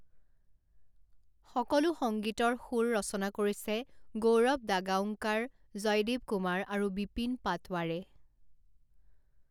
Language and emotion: Assamese, neutral